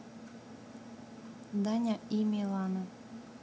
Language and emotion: Russian, neutral